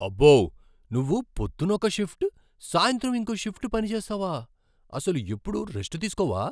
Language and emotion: Telugu, surprised